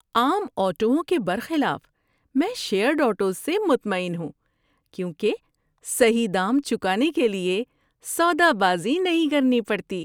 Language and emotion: Urdu, happy